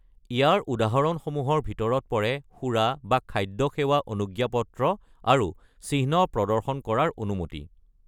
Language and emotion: Assamese, neutral